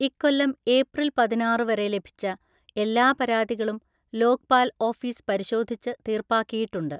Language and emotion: Malayalam, neutral